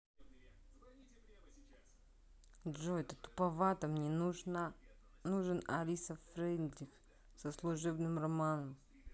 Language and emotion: Russian, angry